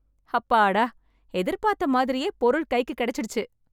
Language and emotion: Tamil, happy